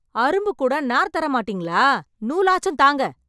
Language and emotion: Tamil, angry